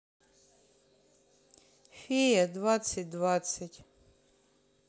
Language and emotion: Russian, neutral